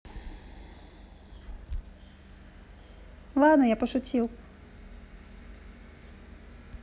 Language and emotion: Russian, neutral